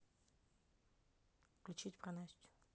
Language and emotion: Russian, neutral